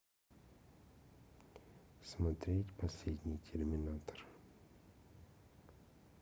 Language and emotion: Russian, neutral